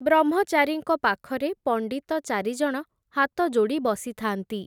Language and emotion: Odia, neutral